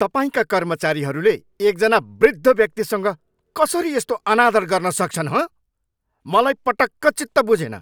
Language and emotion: Nepali, angry